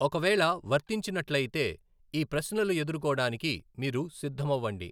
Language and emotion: Telugu, neutral